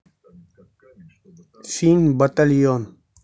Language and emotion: Russian, neutral